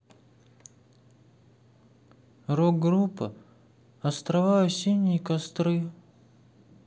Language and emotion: Russian, sad